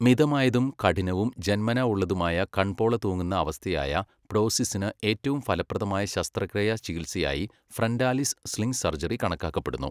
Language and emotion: Malayalam, neutral